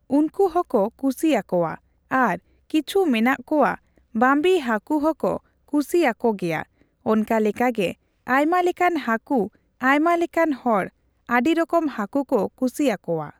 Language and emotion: Santali, neutral